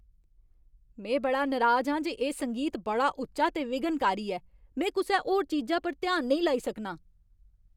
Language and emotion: Dogri, angry